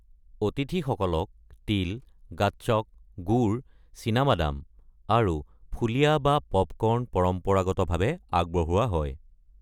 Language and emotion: Assamese, neutral